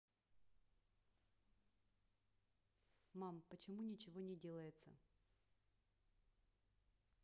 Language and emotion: Russian, angry